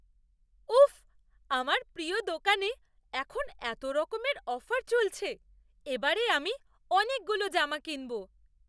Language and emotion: Bengali, surprised